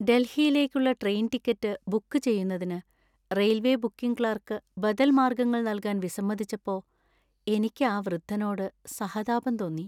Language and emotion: Malayalam, sad